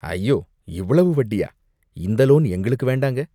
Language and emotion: Tamil, disgusted